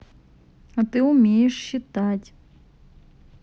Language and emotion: Russian, neutral